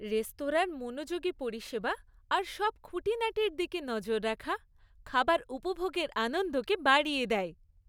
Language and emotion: Bengali, happy